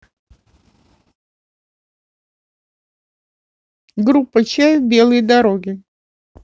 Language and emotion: Russian, neutral